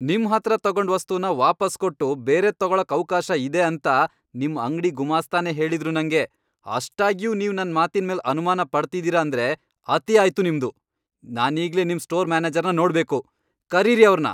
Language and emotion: Kannada, angry